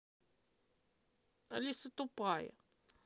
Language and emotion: Russian, angry